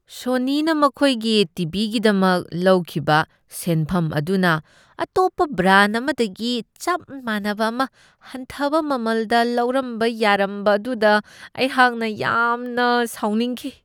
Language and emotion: Manipuri, disgusted